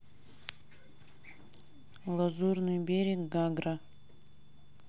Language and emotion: Russian, neutral